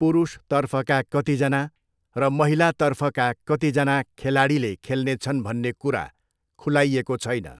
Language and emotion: Nepali, neutral